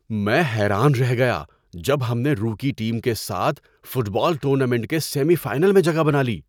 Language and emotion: Urdu, surprised